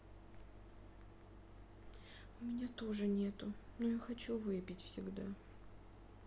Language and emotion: Russian, sad